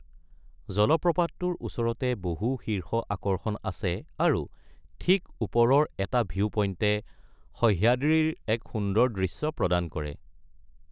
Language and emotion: Assamese, neutral